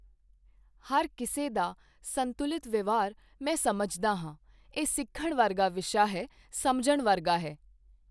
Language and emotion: Punjabi, neutral